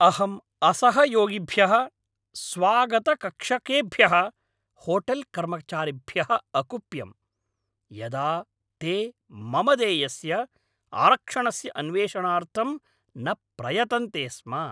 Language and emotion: Sanskrit, angry